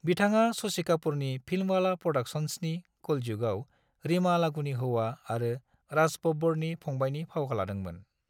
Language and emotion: Bodo, neutral